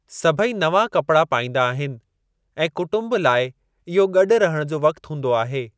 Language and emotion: Sindhi, neutral